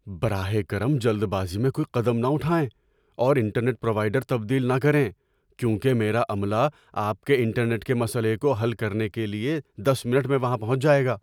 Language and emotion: Urdu, fearful